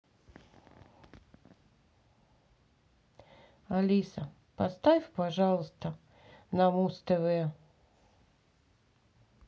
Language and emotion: Russian, neutral